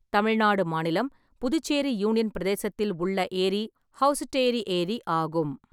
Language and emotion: Tamil, neutral